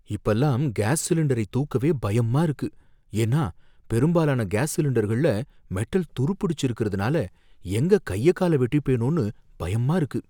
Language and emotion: Tamil, fearful